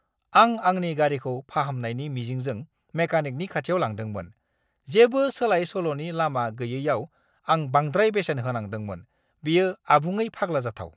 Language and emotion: Bodo, angry